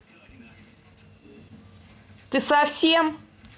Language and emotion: Russian, angry